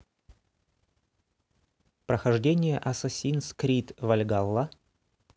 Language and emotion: Russian, neutral